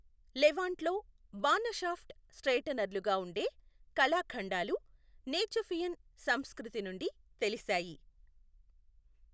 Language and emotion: Telugu, neutral